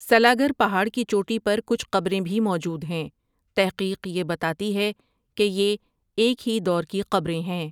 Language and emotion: Urdu, neutral